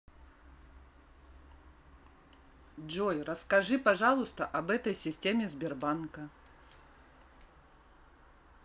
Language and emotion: Russian, neutral